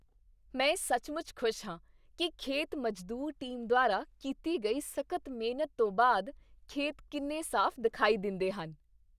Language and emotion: Punjabi, happy